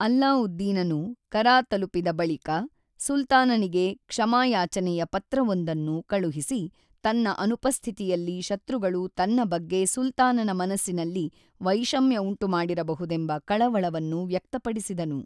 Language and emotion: Kannada, neutral